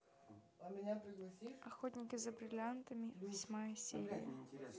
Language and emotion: Russian, neutral